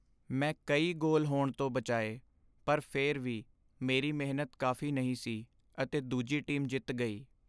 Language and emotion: Punjabi, sad